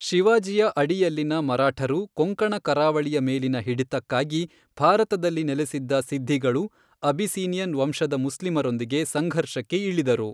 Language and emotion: Kannada, neutral